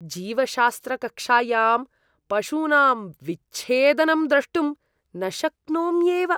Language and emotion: Sanskrit, disgusted